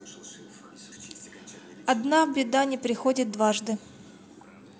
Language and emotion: Russian, neutral